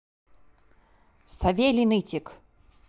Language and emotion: Russian, neutral